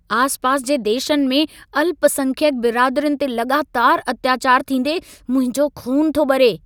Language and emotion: Sindhi, angry